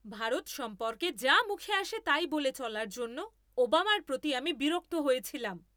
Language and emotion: Bengali, angry